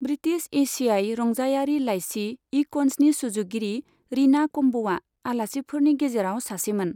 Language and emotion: Bodo, neutral